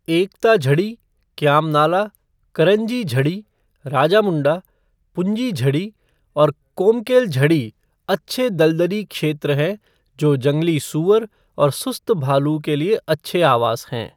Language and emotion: Hindi, neutral